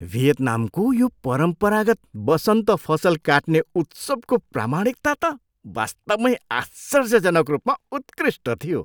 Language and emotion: Nepali, surprised